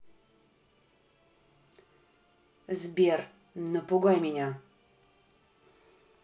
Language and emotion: Russian, angry